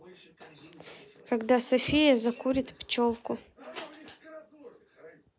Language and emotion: Russian, neutral